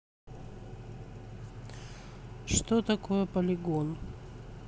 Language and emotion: Russian, neutral